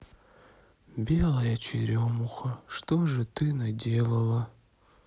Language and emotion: Russian, sad